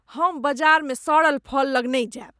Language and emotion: Maithili, disgusted